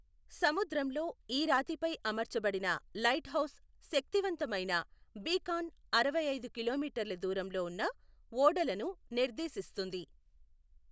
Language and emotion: Telugu, neutral